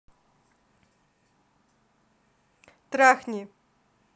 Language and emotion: Russian, neutral